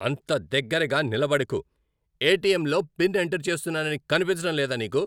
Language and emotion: Telugu, angry